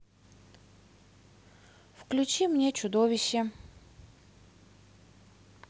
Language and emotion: Russian, neutral